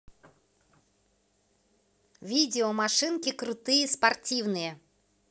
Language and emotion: Russian, positive